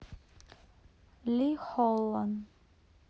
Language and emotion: Russian, neutral